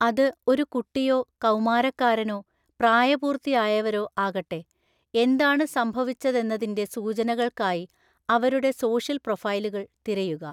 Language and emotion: Malayalam, neutral